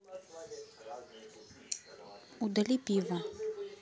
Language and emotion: Russian, neutral